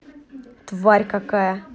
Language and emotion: Russian, angry